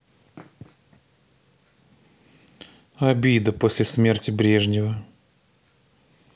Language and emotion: Russian, neutral